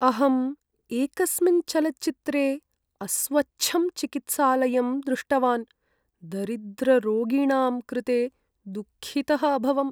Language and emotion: Sanskrit, sad